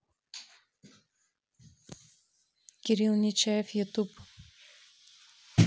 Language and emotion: Russian, neutral